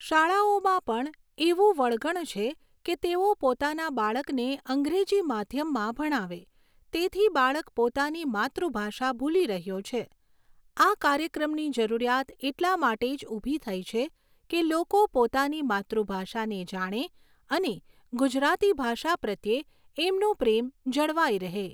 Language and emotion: Gujarati, neutral